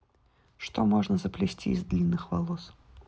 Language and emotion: Russian, neutral